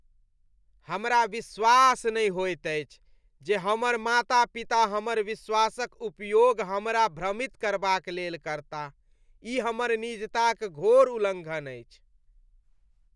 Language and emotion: Maithili, disgusted